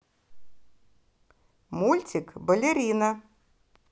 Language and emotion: Russian, positive